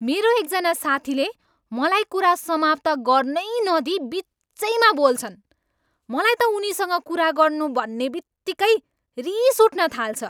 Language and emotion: Nepali, angry